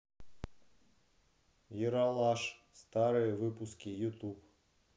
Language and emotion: Russian, neutral